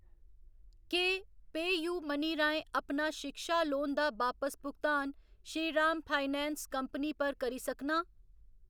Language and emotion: Dogri, neutral